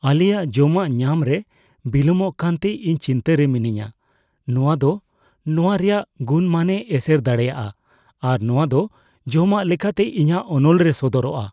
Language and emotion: Santali, fearful